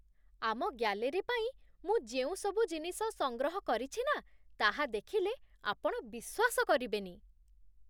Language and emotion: Odia, surprised